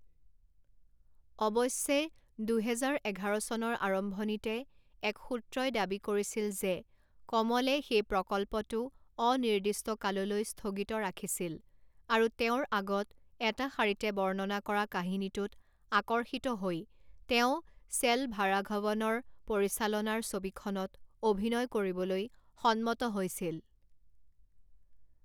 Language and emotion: Assamese, neutral